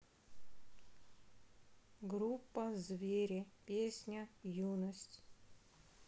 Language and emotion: Russian, sad